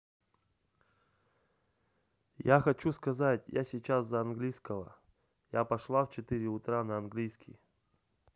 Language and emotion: Russian, neutral